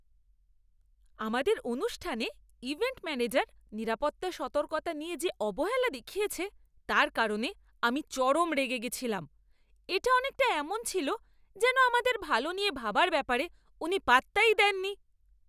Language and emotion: Bengali, angry